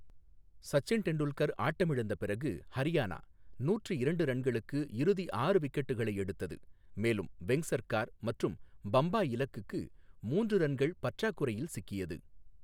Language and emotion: Tamil, neutral